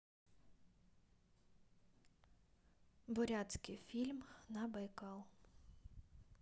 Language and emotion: Russian, neutral